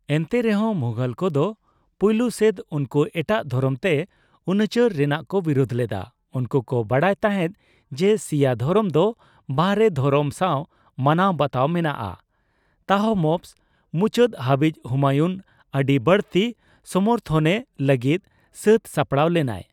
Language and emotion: Santali, neutral